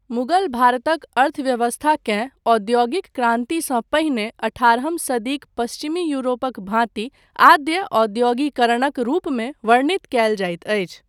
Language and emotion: Maithili, neutral